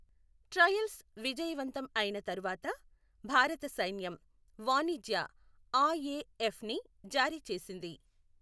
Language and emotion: Telugu, neutral